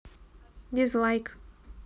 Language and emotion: Russian, neutral